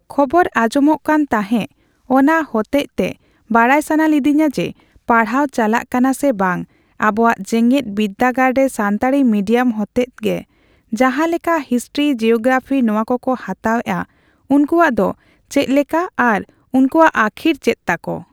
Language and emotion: Santali, neutral